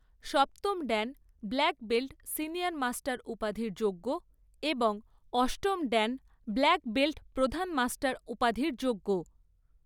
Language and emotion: Bengali, neutral